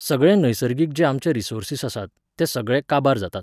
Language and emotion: Goan Konkani, neutral